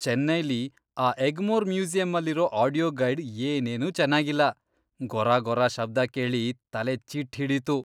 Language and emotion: Kannada, disgusted